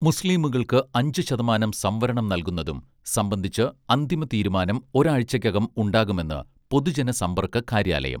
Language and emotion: Malayalam, neutral